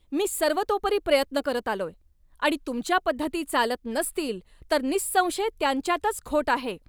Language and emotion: Marathi, angry